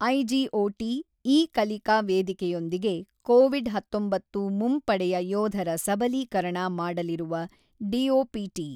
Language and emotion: Kannada, neutral